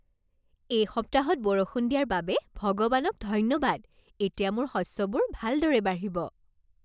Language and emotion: Assamese, happy